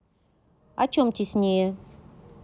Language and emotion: Russian, neutral